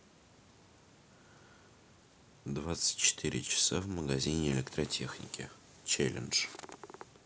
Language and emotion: Russian, neutral